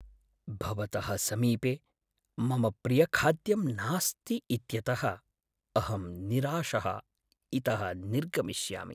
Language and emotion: Sanskrit, sad